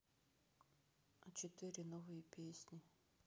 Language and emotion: Russian, sad